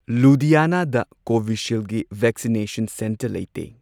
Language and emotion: Manipuri, neutral